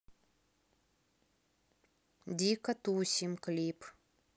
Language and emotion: Russian, neutral